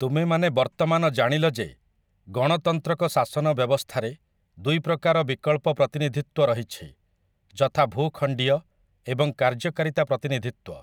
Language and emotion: Odia, neutral